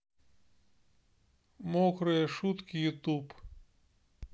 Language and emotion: Russian, neutral